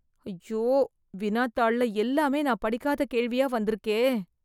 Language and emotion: Tamil, fearful